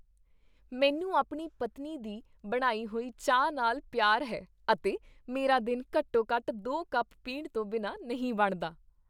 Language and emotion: Punjabi, happy